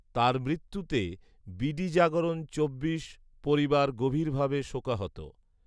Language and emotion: Bengali, neutral